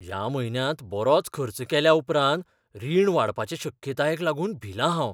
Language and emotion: Goan Konkani, fearful